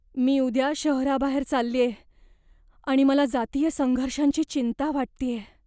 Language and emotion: Marathi, fearful